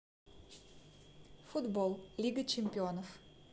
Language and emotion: Russian, neutral